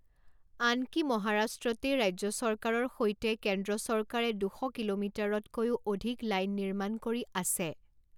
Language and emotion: Assamese, neutral